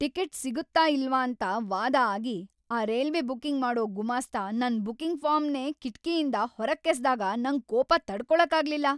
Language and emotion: Kannada, angry